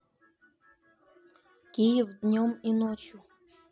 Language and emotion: Russian, neutral